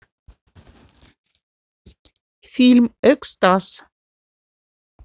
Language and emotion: Russian, neutral